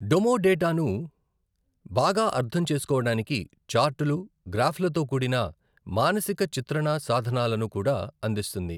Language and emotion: Telugu, neutral